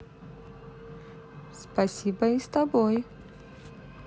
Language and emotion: Russian, positive